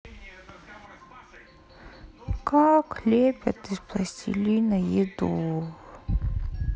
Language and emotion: Russian, sad